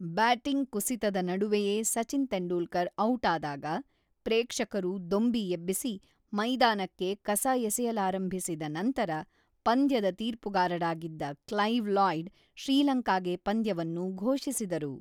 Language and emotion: Kannada, neutral